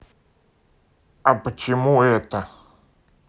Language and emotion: Russian, neutral